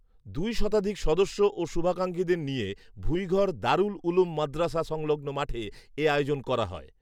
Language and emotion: Bengali, neutral